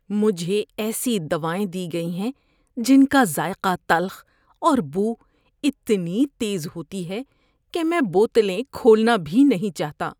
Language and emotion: Urdu, disgusted